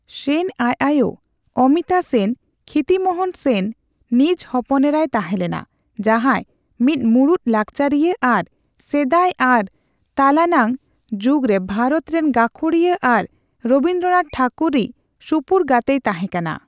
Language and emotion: Santali, neutral